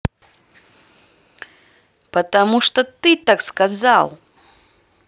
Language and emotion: Russian, angry